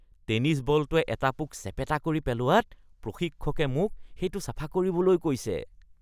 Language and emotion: Assamese, disgusted